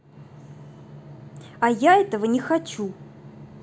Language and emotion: Russian, angry